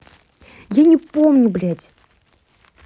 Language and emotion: Russian, angry